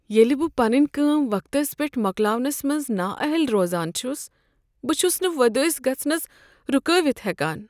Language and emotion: Kashmiri, sad